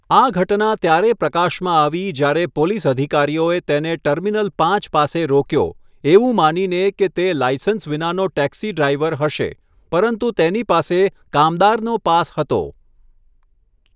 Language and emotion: Gujarati, neutral